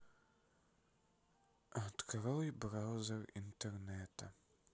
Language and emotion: Russian, sad